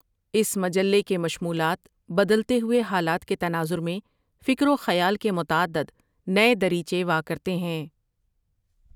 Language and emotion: Urdu, neutral